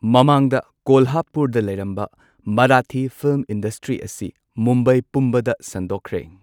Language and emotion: Manipuri, neutral